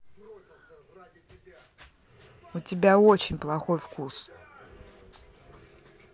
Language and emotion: Russian, angry